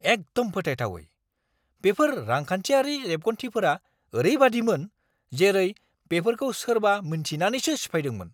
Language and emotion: Bodo, angry